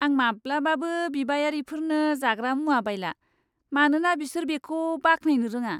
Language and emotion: Bodo, disgusted